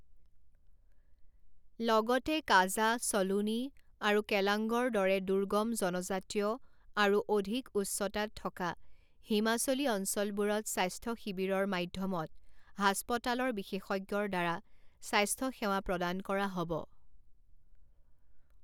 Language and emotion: Assamese, neutral